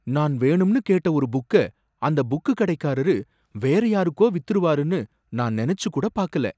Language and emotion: Tamil, surprised